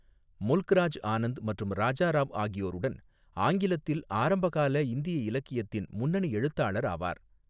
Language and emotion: Tamil, neutral